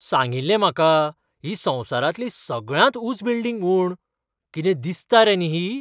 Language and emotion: Goan Konkani, surprised